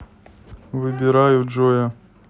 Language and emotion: Russian, neutral